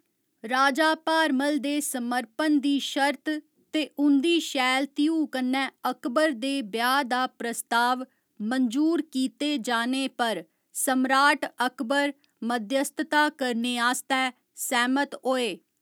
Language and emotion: Dogri, neutral